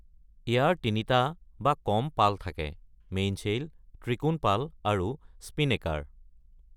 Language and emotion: Assamese, neutral